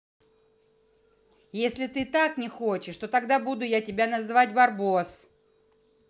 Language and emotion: Russian, angry